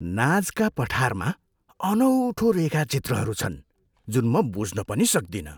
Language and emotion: Nepali, surprised